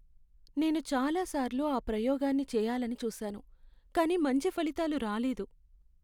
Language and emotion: Telugu, sad